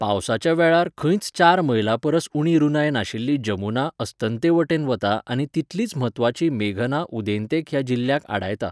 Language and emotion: Goan Konkani, neutral